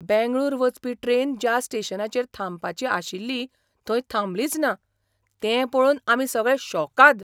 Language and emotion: Goan Konkani, surprised